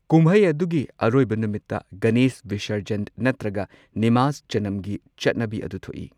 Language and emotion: Manipuri, neutral